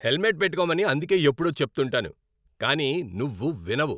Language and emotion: Telugu, angry